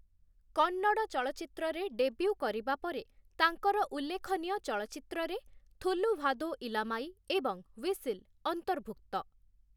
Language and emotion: Odia, neutral